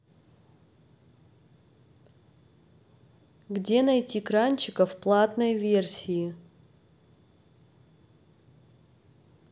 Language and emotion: Russian, neutral